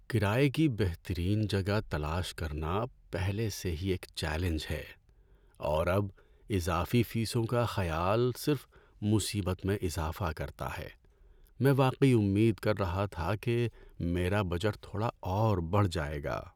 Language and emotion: Urdu, sad